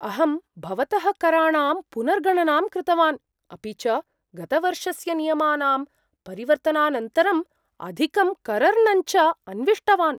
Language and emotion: Sanskrit, surprised